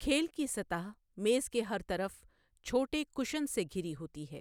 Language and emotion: Urdu, neutral